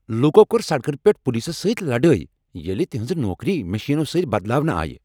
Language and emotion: Kashmiri, angry